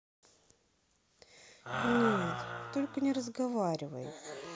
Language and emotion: Russian, sad